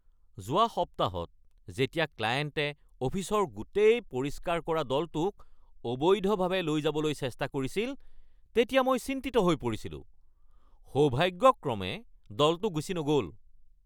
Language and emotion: Assamese, angry